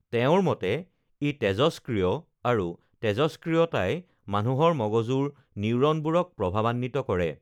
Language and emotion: Assamese, neutral